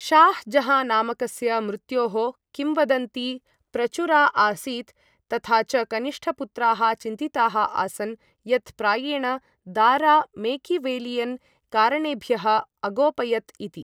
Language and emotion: Sanskrit, neutral